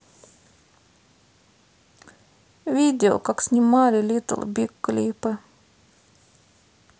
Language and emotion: Russian, sad